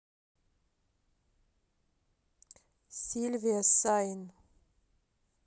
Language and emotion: Russian, neutral